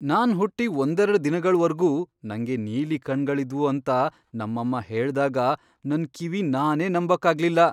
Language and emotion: Kannada, surprised